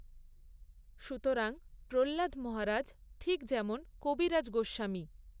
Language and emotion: Bengali, neutral